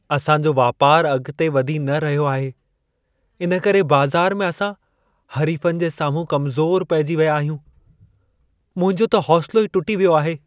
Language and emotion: Sindhi, sad